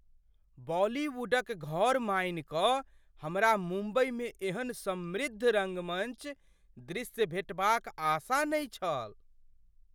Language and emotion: Maithili, surprised